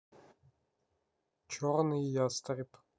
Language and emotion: Russian, neutral